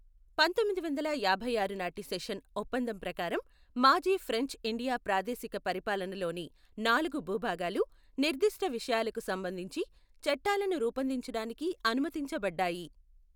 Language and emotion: Telugu, neutral